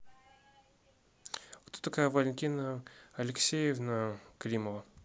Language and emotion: Russian, neutral